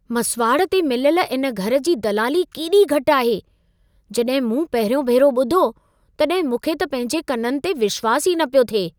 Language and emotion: Sindhi, surprised